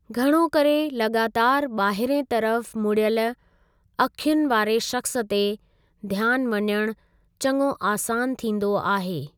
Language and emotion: Sindhi, neutral